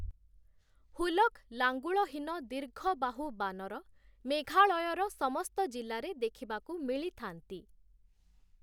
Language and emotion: Odia, neutral